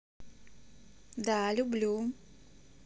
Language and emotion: Russian, positive